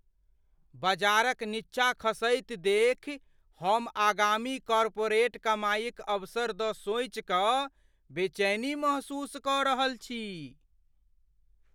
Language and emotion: Maithili, fearful